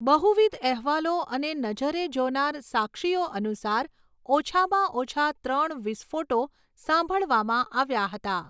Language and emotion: Gujarati, neutral